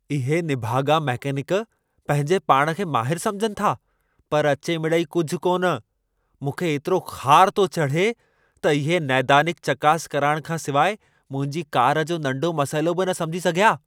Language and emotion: Sindhi, angry